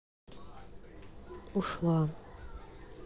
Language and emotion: Russian, sad